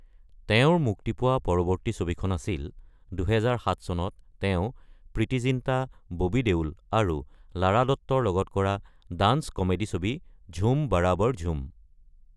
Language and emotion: Assamese, neutral